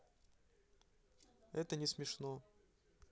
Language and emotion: Russian, neutral